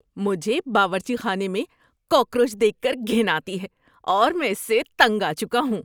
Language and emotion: Urdu, disgusted